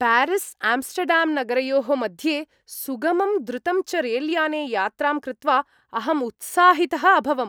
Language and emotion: Sanskrit, happy